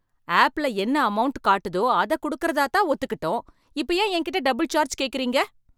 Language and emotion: Tamil, angry